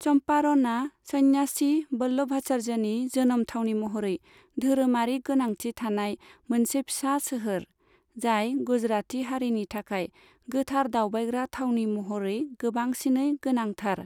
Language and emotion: Bodo, neutral